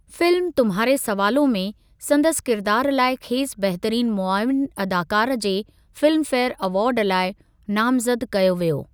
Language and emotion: Sindhi, neutral